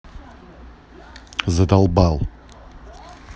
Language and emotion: Russian, angry